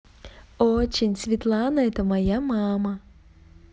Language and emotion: Russian, positive